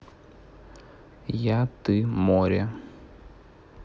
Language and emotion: Russian, neutral